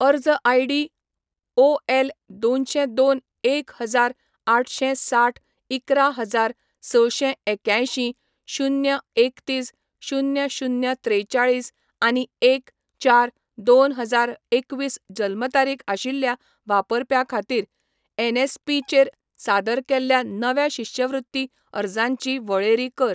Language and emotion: Goan Konkani, neutral